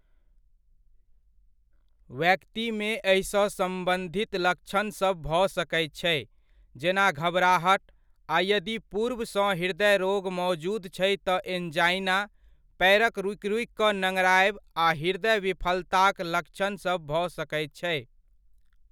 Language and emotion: Maithili, neutral